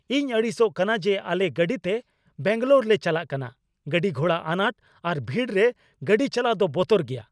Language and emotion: Santali, angry